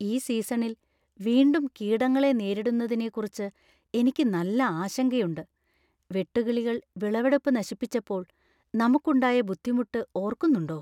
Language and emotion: Malayalam, fearful